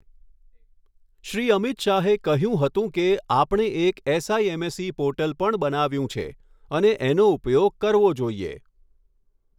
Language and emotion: Gujarati, neutral